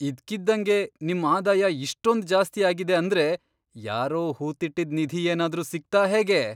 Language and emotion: Kannada, surprised